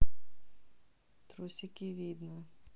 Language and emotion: Russian, neutral